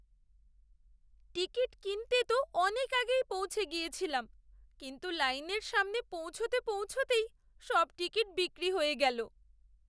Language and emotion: Bengali, sad